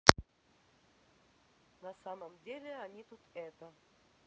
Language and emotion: Russian, neutral